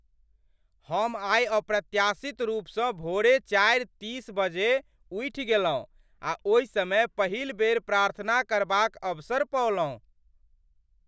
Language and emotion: Maithili, surprised